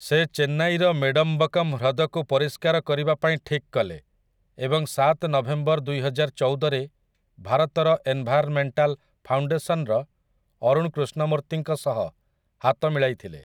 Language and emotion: Odia, neutral